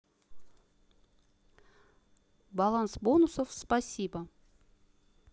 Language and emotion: Russian, neutral